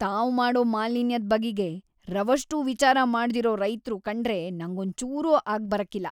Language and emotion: Kannada, disgusted